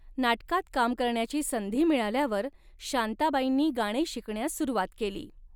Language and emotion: Marathi, neutral